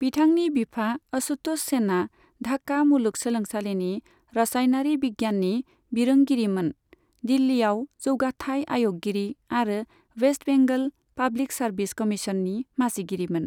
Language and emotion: Bodo, neutral